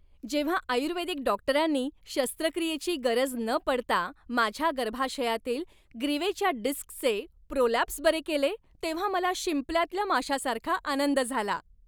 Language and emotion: Marathi, happy